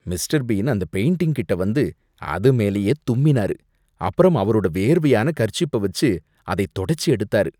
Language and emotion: Tamil, disgusted